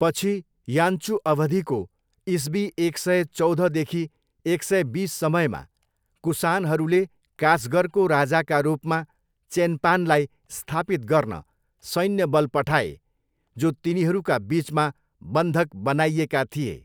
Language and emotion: Nepali, neutral